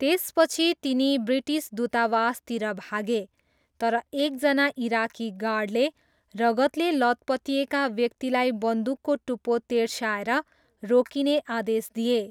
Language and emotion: Nepali, neutral